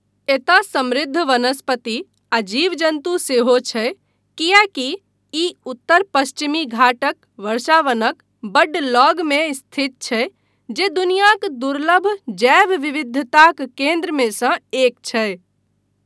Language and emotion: Maithili, neutral